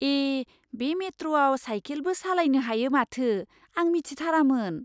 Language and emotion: Bodo, surprised